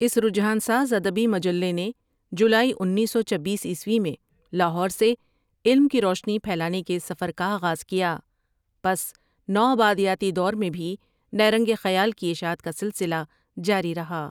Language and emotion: Urdu, neutral